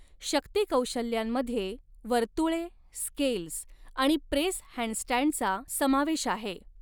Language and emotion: Marathi, neutral